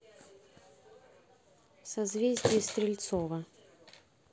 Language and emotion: Russian, neutral